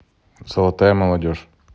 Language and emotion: Russian, neutral